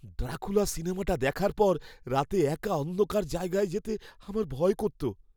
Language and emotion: Bengali, fearful